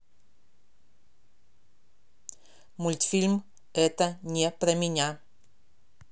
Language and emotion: Russian, neutral